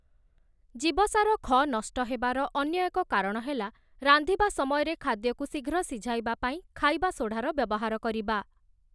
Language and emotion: Odia, neutral